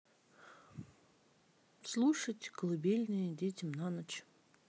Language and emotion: Russian, neutral